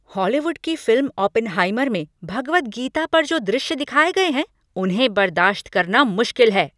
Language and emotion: Hindi, angry